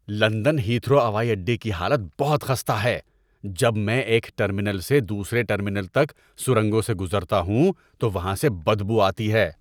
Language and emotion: Urdu, disgusted